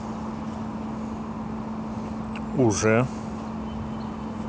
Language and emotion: Russian, neutral